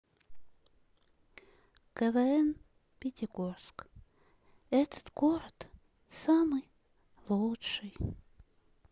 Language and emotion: Russian, sad